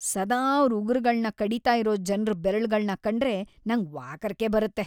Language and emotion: Kannada, disgusted